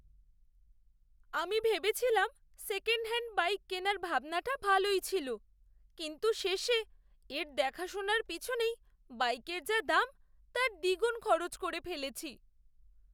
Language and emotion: Bengali, sad